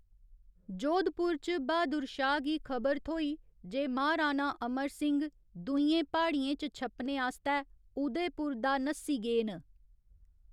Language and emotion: Dogri, neutral